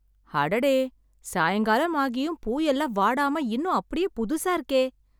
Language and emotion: Tamil, surprised